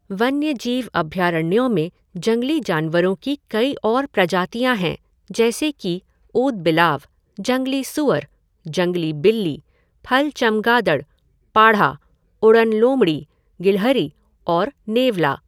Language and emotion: Hindi, neutral